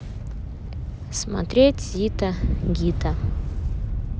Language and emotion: Russian, neutral